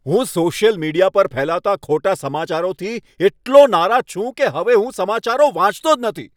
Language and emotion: Gujarati, angry